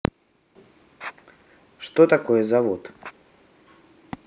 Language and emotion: Russian, neutral